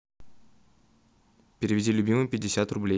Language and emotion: Russian, neutral